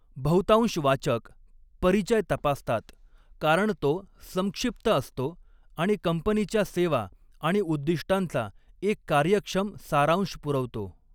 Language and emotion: Marathi, neutral